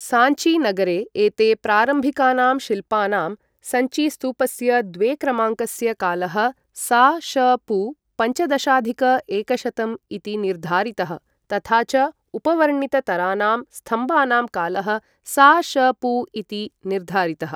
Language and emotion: Sanskrit, neutral